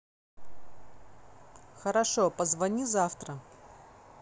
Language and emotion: Russian, neutral